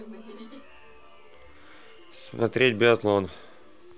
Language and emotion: Russian, neutral